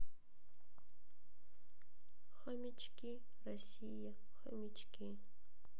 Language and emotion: Russian, sad